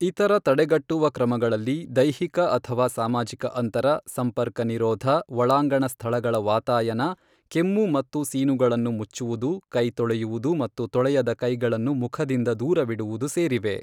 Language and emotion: Kannada, neutral